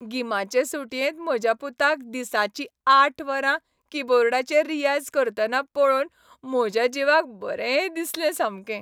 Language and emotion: Goan Konkani, happy